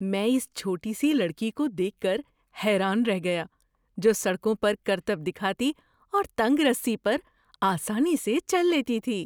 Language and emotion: Urdu, surprised